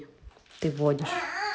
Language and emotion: Russian, neutral